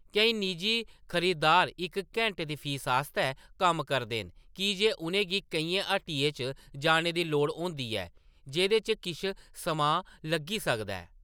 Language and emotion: Dogri, neutral